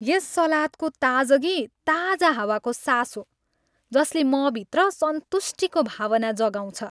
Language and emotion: Nepali, happy